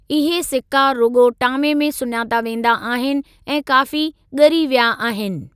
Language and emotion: Sindhi, neutral